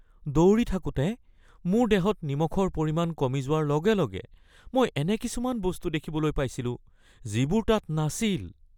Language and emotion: Assamese, fearful